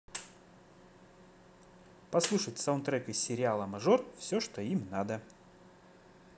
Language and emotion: Russian, positive